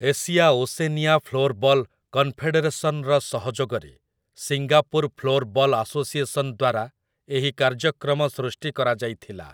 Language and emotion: Odia, neutral